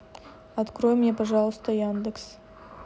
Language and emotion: Russian, neutral